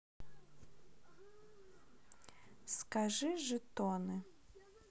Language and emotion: Russian, neutral